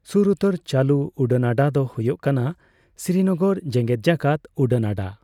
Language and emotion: Santali, neutral